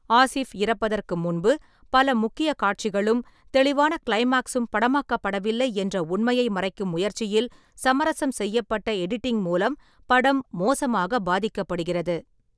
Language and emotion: Tamil, neutral